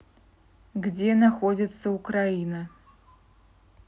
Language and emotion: Russian, neutral